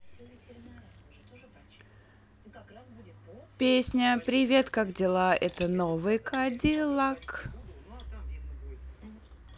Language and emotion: Russian, positive